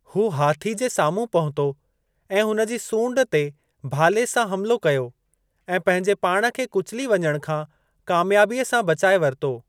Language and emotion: Sindhi, neutral